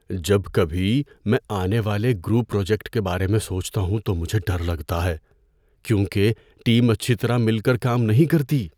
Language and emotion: Urdu, fearful